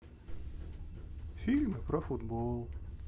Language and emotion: Russian, sad